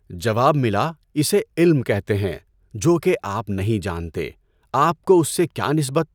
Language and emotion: Urdu, neutral